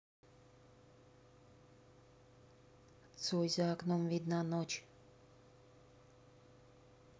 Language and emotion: Russian, neutral